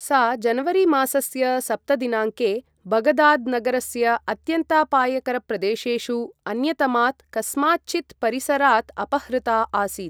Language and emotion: Sanskrit, neutral